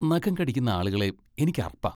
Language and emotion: Malayalam, disgusted